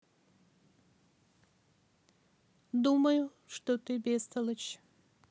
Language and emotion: Russian, neutral